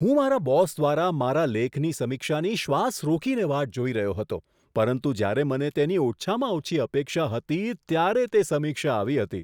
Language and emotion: Gujarati, surprised